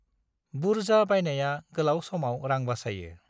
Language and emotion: Bodo, neutral